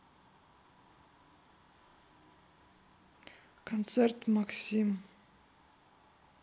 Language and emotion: Russian, neutral